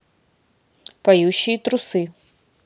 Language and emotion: Russian, neutral